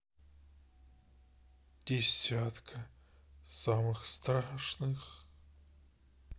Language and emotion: Russian, sad